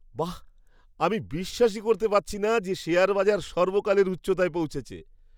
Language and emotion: Bengali, surprised